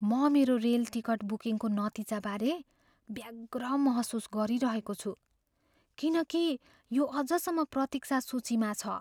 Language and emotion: Nepali, fearful